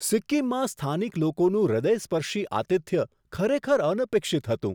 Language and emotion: Gujarati, surprised